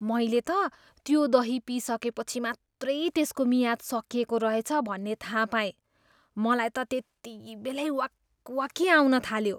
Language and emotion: Nepali, disgusted